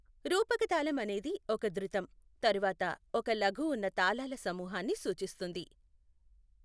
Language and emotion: Telugu, neutral